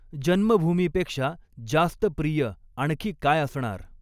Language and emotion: Marathi, neutral